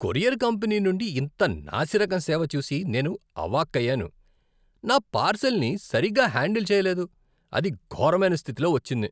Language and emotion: Telugu, disgusted